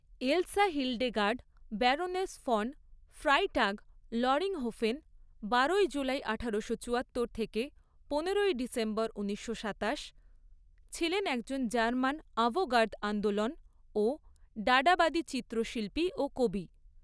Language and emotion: Bengali, neutral